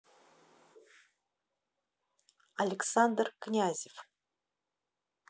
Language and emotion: Russian, neutral